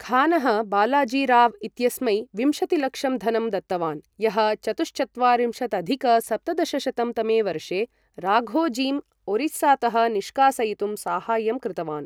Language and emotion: Sanskrit, neutral